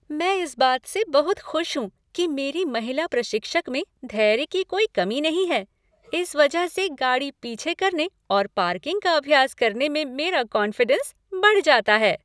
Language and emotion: Hindi, happy